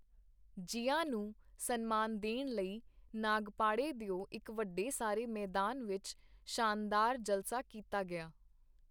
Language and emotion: Punjabi, neutral